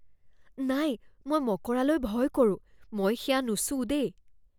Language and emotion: Assamese, fearful